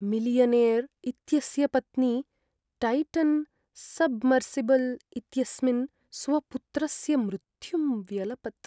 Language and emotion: Sanskrit, sad